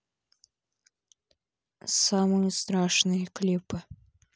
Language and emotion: Russian, neutral